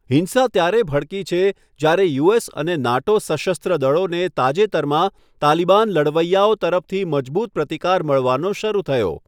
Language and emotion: Gujarati, neutral